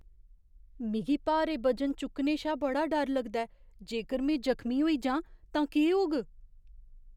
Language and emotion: Dogri, fearful